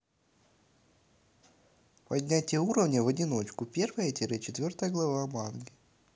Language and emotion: Russian, neutral